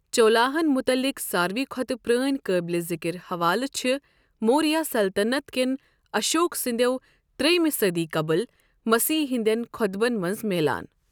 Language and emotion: Kashmiri, neutral